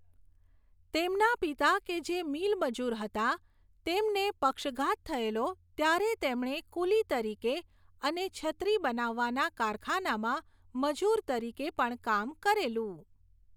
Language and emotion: Gujarati, neutral